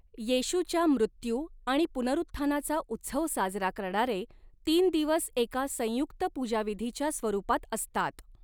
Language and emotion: Marathi, neutral